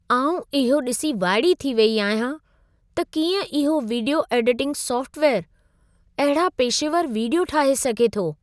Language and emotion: Sindhi, surprised